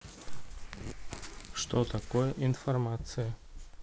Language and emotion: Russian, neutral